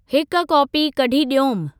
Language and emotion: Sindhi, neutral